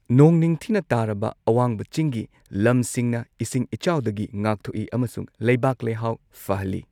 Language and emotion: Manipuri, neutral